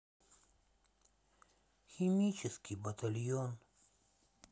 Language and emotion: Russian, sad